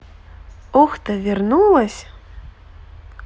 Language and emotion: Russian, positive